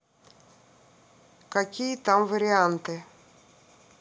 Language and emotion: Russian, neutral